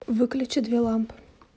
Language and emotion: Russian, neutral